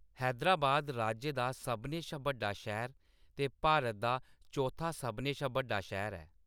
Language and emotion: Dogri, neutral